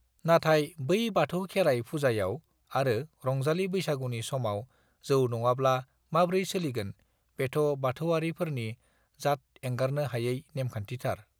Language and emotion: Bodo, neutral